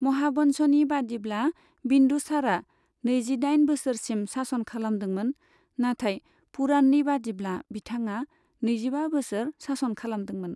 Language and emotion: Bodo, neutral